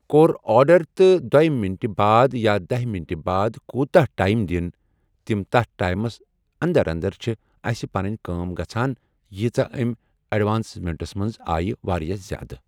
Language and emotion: Kashmiri, neutral